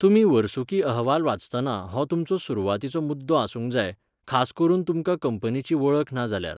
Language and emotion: Goan Konkani, neutral